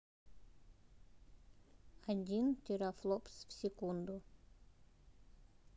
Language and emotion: Russian, neutral